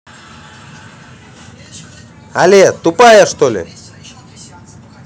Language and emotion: Russian, angry